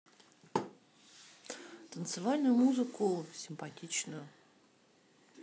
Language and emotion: Russian, neutral